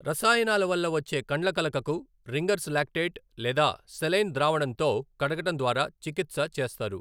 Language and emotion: Telugu, neutral